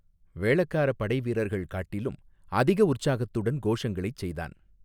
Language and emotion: Tamil, neutral